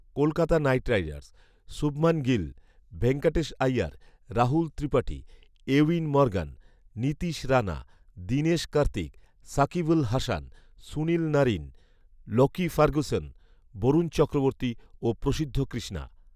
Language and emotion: Bengali, neutral